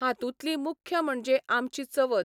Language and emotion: Goan Konkani, neutral